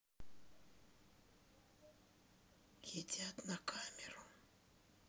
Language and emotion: Russian, sad